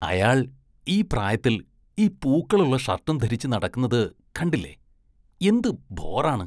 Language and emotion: Malayalam, disgusted